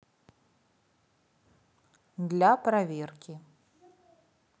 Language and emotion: Russian, neutral